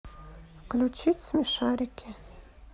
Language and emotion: Russian, neutral